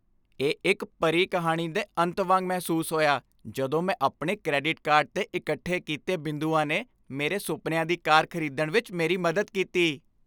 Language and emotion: Punjabi, happy